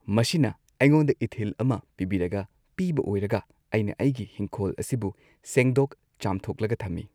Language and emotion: Manipuri, neutral